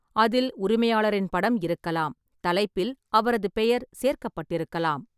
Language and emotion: Tamil, neutral